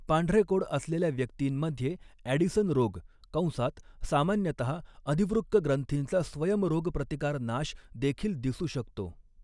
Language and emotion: Marathi, neutral